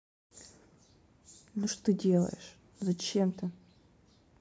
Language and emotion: Russian, angry